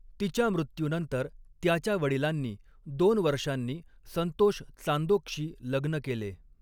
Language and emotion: Marathi, neutral